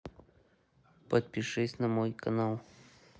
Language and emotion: Russian, neutral